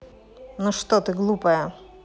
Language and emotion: Russian, neutral